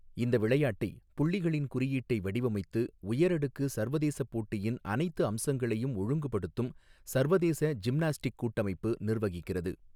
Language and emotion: Tamil, neutral